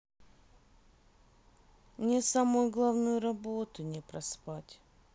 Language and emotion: Russian, sad